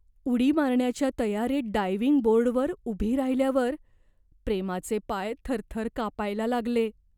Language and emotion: Marathi, fearful